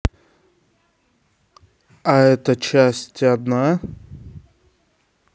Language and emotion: Russian, neutral